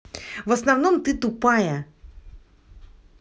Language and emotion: Russian, angry